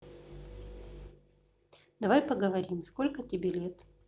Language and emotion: Russian, neutral